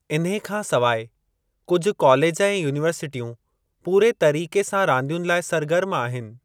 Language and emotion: Sindhi, neutral